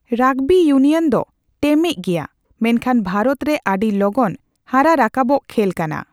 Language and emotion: Santali, neutral